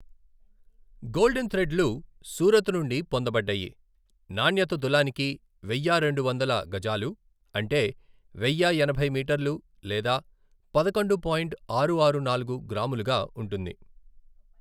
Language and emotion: Telugu, neutral